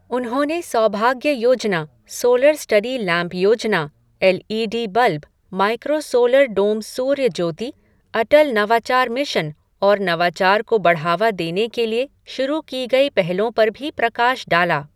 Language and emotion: Hindi, neutral